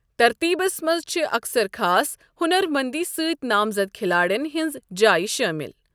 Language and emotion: Kashmiri, neutral